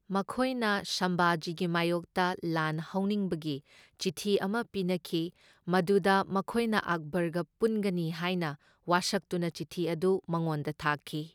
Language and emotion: Manipuri, neutral